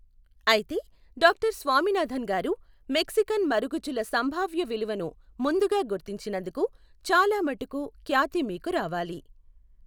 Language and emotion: Telugu, neutral